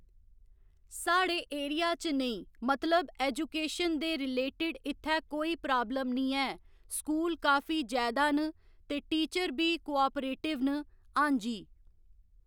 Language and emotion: Dogri, neutral